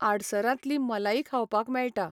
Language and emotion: Goan Konkani, neutral